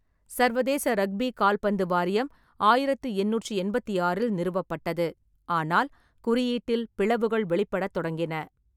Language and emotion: Tamil, neutral